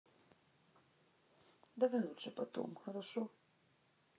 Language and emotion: Russian, sad